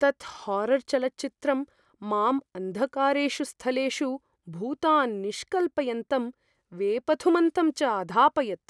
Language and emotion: Sanskrit, fearful